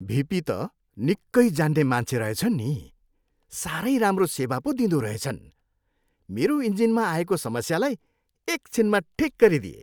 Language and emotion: Nepali, happy